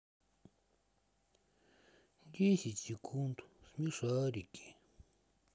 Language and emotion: Russian, sad